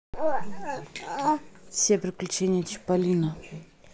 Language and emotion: Russian, neutral